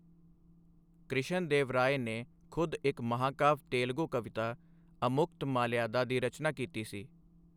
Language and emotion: Punjabi, neutral